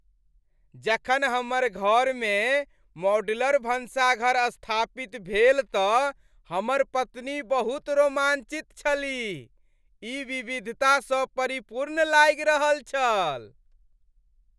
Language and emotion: Maithili, happy